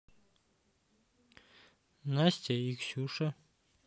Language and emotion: Russian, neutral